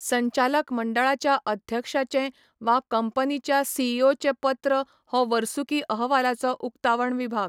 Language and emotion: Goan Konkani, neutral